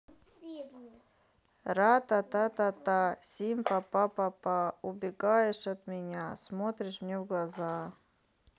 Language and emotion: Russian, neutral